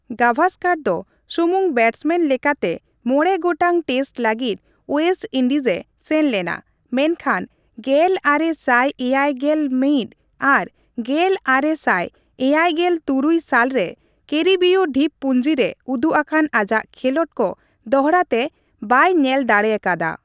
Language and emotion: Santali, neutral